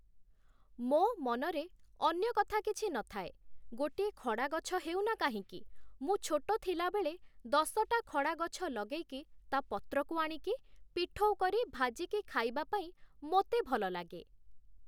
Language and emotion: Odia, neutral